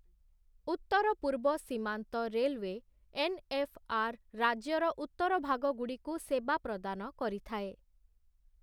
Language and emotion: Odia, neutral